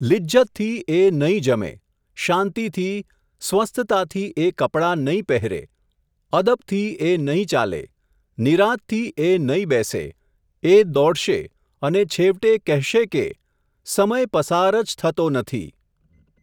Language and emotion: Gujarati, neutral